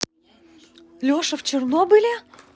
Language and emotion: Russian, positive